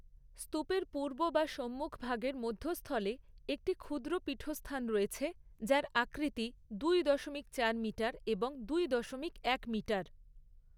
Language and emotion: Bengali, neutral